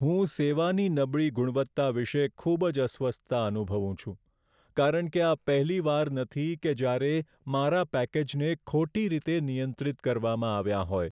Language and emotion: Gujarati, sad